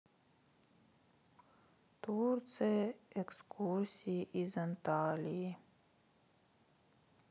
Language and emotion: Russian, sad